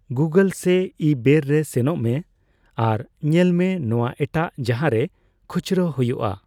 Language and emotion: Santali, neutral